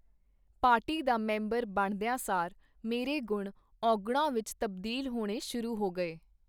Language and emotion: Punjabi, neutral